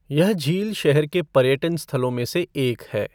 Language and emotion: Hindi, neutral